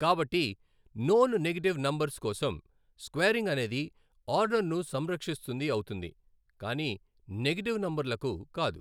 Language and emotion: Telugu, neutral